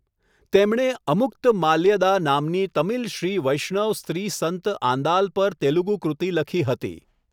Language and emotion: Gujarati, neutral